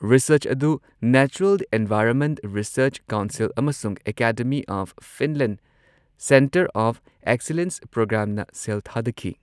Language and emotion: Manipuri, neutral